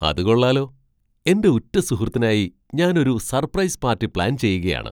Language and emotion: Malayalam, surprised